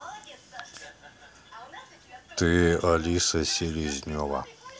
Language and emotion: Russian, neutral